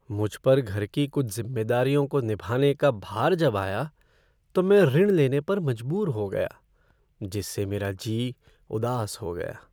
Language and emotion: Hindi, sad